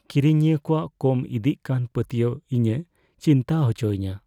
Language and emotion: Santali, fearful